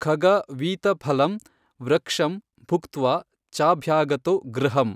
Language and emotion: Kannada, neutral